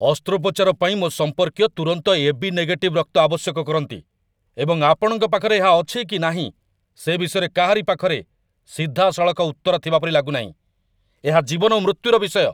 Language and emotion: Odia, angry